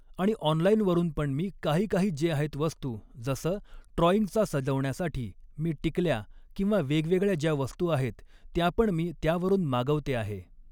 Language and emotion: Marathi, neutral